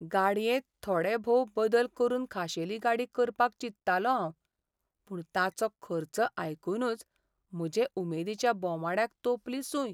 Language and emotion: Goan Konkani, sad